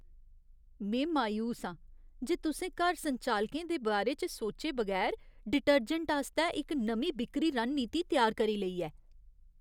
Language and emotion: Dogri, disgusted